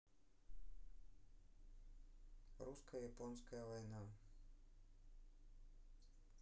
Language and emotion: Russian, neutral